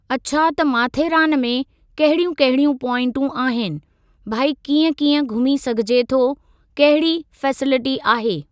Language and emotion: Sindhi, neutral